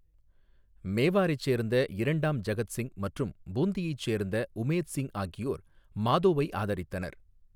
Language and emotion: Tamil, neutral